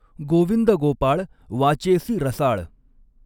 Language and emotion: Marathi, neutral